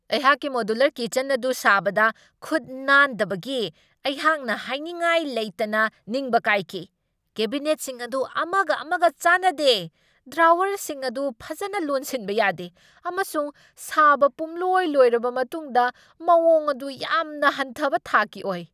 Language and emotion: Manipuri, angry